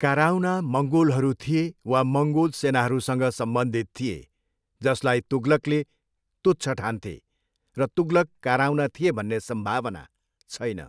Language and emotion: Nepali, neutral